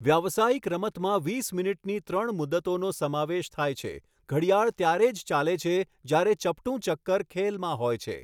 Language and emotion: Gujarati, neutral